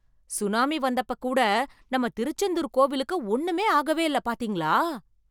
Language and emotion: Tamil, surprised